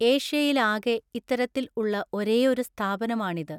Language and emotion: Malayalam, neutral